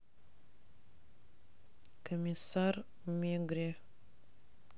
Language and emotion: Russian, neutral